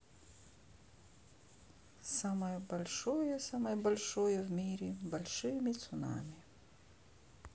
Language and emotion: Russian, sad